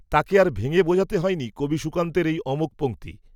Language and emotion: Bengali, neutral